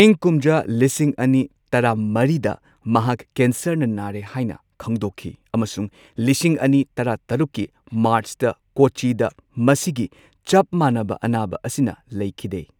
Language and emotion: Manipuri, neutral